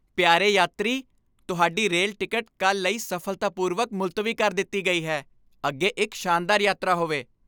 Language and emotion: Punjabi, happy